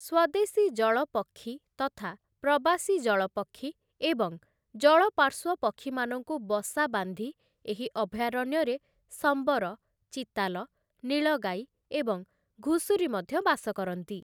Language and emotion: Odia, neutral